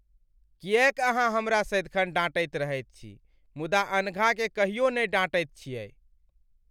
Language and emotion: Maithili, sad